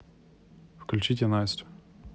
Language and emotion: Russian, neutral